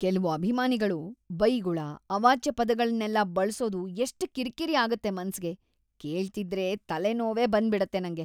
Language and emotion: Kannada, disgusted